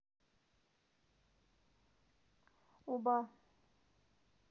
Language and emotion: Russian, neutral